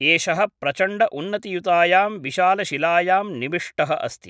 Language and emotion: Sanskrit, neutral